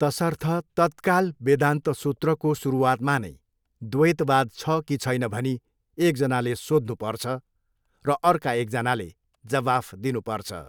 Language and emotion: Nepali, neutral